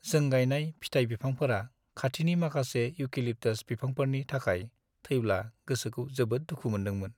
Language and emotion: Bodo, sad